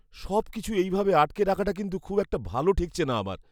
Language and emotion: Bengali, fearful